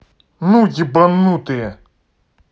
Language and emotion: Russian, angry